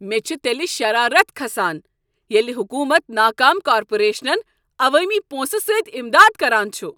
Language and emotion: Kashmiri, angry